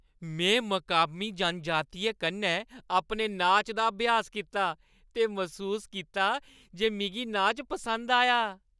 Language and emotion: Dogri, happy